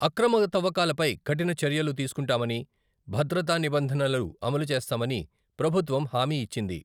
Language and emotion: Telugu, neutral